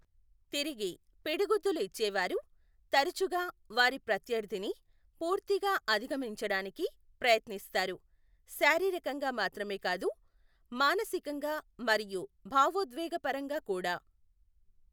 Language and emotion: Telugu, neutral